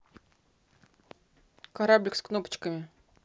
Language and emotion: Russian, neutral